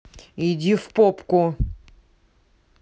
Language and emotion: Russian, angry